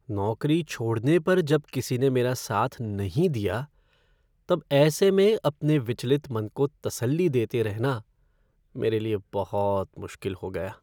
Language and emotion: Hindi, sad